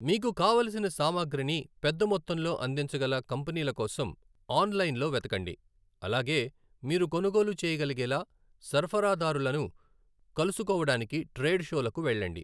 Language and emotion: Telugu, neutral